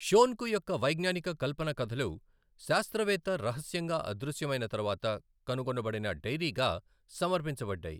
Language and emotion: Telugu, neutral